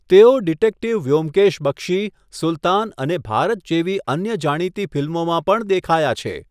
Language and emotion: Gujarati, neutral